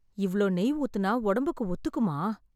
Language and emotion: Tamil, fearful